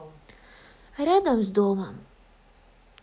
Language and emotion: Russian, sad